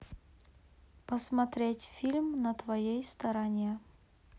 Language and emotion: Russian, neutral